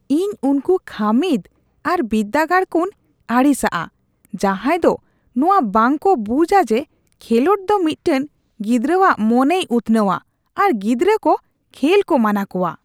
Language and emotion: Santali, disgusted